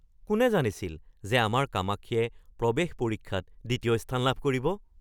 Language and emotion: Assamese, surprised